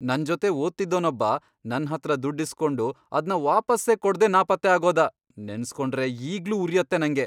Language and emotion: Kannada, angry